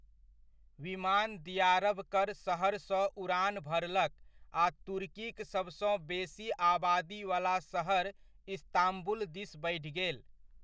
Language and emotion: Maithili, neutral